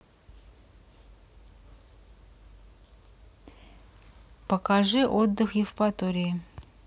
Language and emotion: Russian, neutral